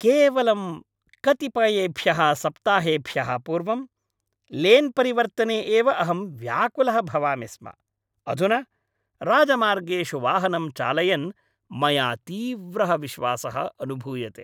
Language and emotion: Sanskrit, happy